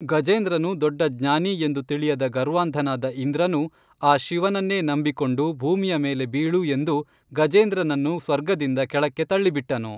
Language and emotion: Kannada, neutral